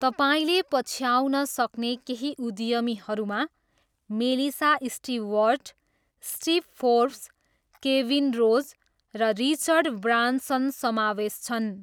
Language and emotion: Nepali, neutral